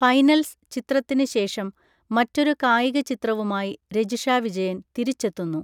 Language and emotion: Malayalam, neutral